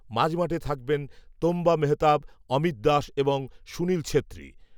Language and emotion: Bengali, neutral